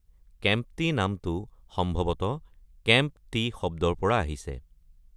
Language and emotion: Assamese, neutral